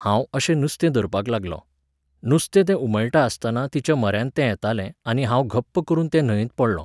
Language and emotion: Goan Konkani, neutral